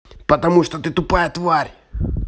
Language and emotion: Russian, angry